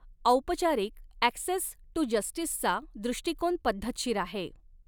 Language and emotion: Marathi, neutral